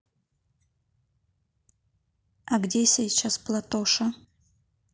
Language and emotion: Russian, neutral